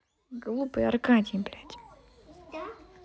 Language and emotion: Russian, angry